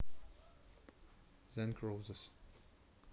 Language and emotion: Russian, neutral